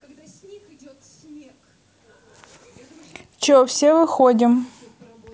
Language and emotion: Russian, neutral